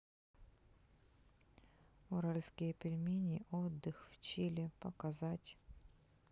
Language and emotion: Russian, neutral